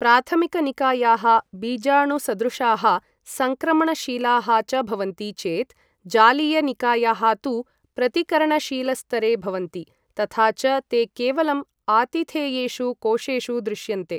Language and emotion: Sanskrit, neutral